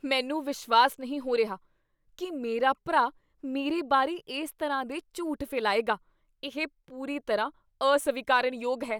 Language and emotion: Punjabi, disgusted